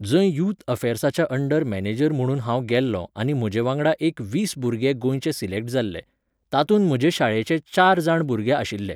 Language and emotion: Goan Konkani, neutral